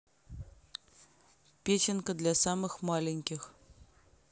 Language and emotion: Russian, neutral